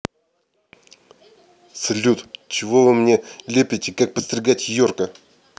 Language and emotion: Russian, angry